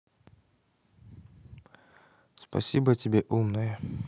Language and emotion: Russian, neutral